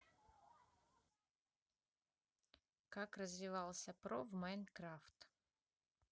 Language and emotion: Russian, neutral